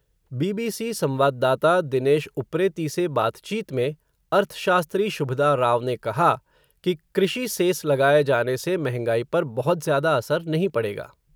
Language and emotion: Hindi, neutral